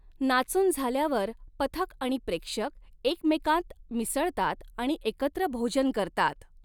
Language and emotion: Marathi, neutral